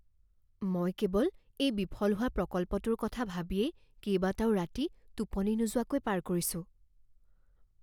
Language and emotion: Assamese, fearful